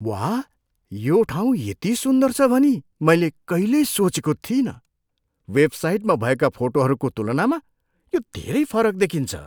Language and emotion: Nepali, surprised